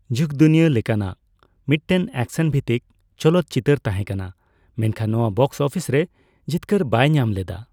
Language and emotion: Santali, neutral